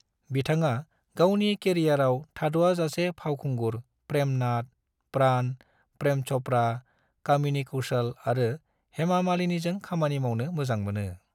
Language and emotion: Bodo, neutral